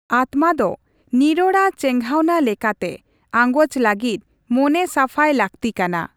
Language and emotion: Santali, neutral